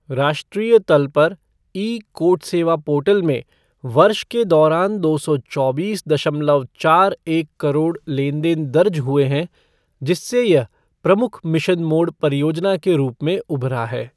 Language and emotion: Hindi, neutral